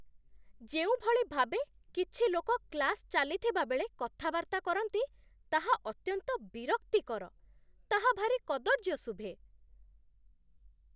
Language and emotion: Odia, disgusted